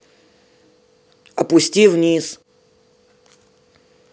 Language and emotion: Russian, angry